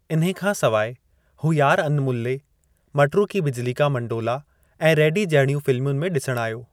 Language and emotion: Sindhi, neutral